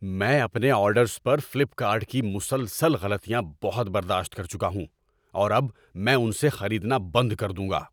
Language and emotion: Urdu, angry